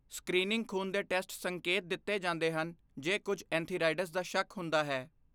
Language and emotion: Punjabi, neutral